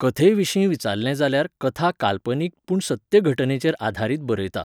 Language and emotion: Goan Konkani, neutral